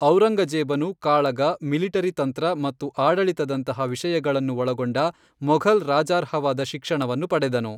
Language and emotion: Kannada, neutral